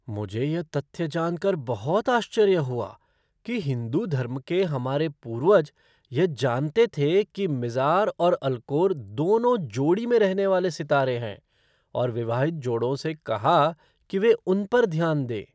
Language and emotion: Hindi, surprised